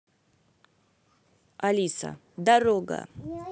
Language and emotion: Russian, neutral